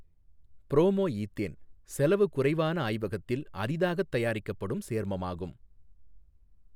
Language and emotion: Tamil, neutral